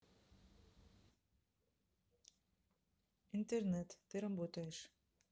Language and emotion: Russian, neutral